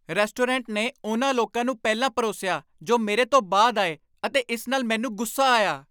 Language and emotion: Punjabi, angry